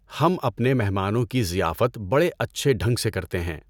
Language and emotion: Urdu, neutral